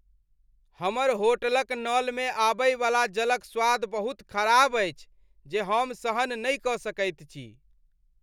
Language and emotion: Maithili, disgusted